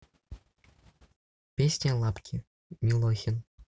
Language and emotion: Russian, neutral